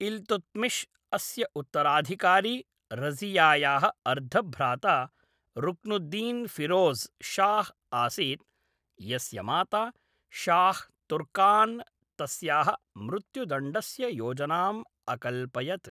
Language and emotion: Sanskrit, neutral